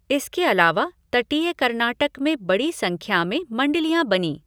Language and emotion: Hindi, neutral